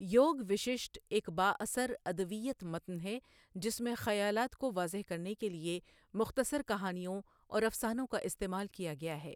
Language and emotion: Urdu, neutral